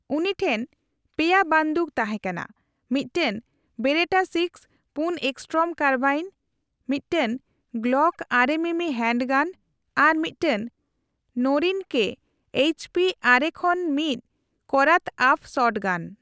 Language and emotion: Santali, neutral